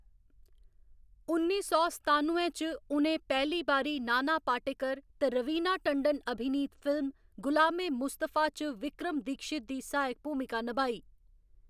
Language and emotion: Dogri, neutral